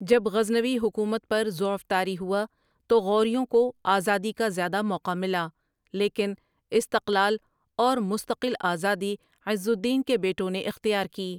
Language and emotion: Urdu, neutral